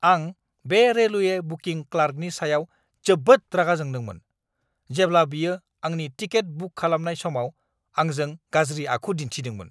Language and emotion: Bodo, angry